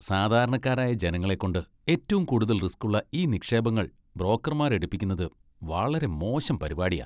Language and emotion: Malayalam, disgusted